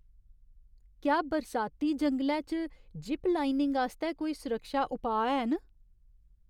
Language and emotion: Dogri, fearful